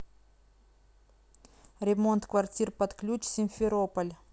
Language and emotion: Russian, neutral